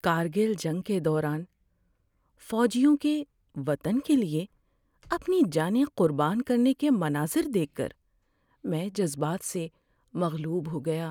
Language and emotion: Urdu, sad